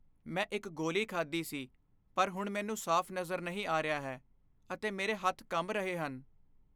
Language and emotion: Punjabi, fearful